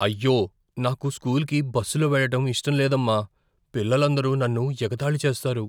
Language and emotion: Telugu, fearful